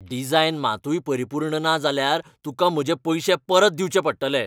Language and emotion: Goan Konkani, angry